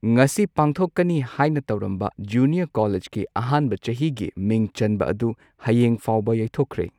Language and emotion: Manipuri, neutral